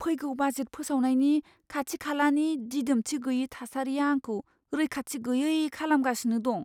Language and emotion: Bodo, fearful